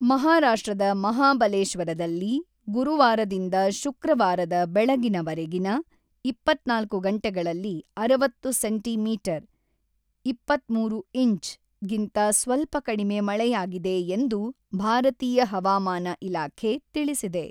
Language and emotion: Kannada, neutral